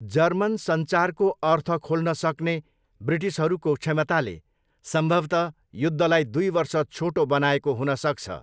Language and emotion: Nepali, neutral